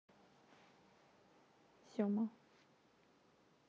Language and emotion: Russian, neutral